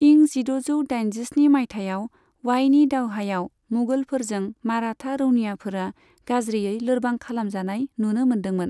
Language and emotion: Bodo, neutral